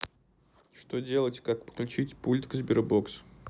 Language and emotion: Russian, neutral